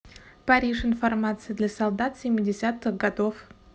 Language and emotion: Russian, neutral